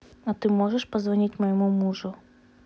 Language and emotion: Russian, neutral